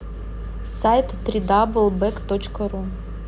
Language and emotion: Russian, neutral